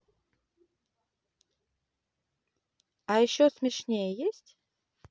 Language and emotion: Russian, positive